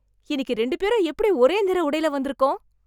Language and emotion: Tamil, surprised